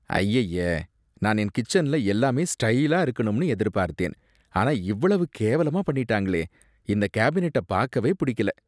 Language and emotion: Tamil, disgusted